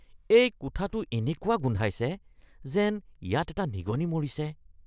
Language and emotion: Assamese, disgusted